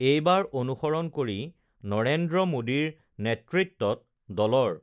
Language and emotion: Assamese, neutral